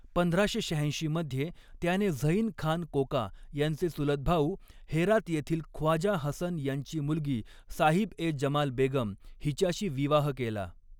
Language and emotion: Marathi, neutral